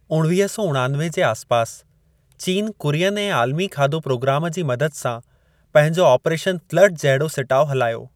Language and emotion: Sindhi, neutral